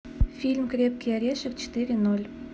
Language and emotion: Russian, neutral